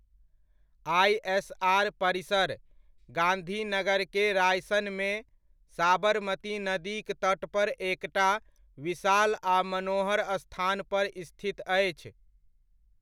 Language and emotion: Maithili, neutral